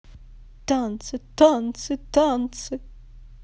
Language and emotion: Russian, positive